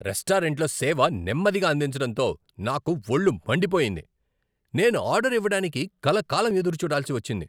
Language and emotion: Telugu, angry